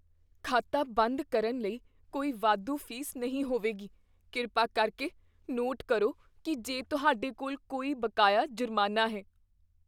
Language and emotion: Punjabi, fearful